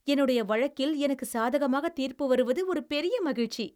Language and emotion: Tamil, happy